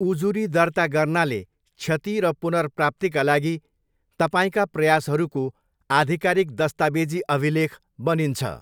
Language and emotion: Nepali, neutral